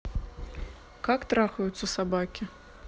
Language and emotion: Russian, neutral